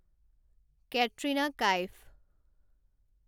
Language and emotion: Assamese, neutral